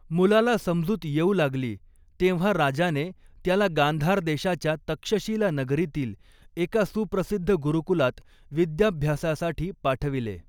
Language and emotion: Marathi, neutral